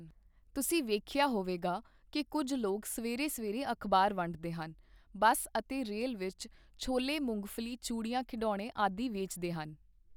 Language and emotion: Punjabi, neutral